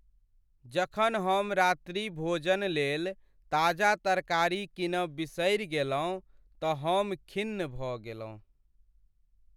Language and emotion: Maithili, sad